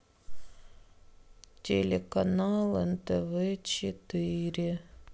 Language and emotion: Russian, sad